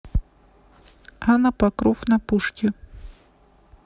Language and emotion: Russian, neutral